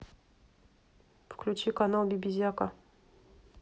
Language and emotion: Russian, neutral